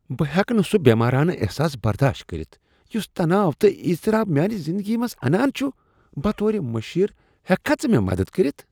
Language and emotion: Kashmiri, disgusted